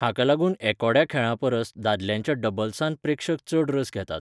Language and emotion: Goan Konkani, neutral